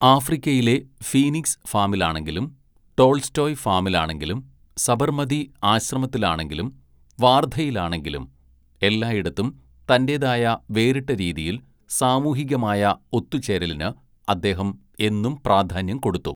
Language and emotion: Malayalam, neutral